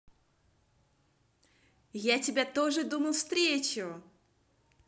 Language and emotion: Russian, positive